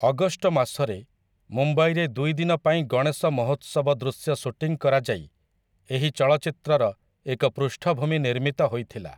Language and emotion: Odia, neutral